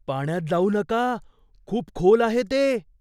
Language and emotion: Marathi, fearful